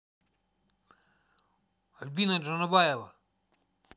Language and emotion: Russian, neutral